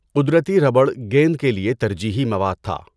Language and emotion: Urdu, neutral